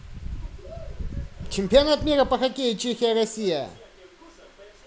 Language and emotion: Russian, positive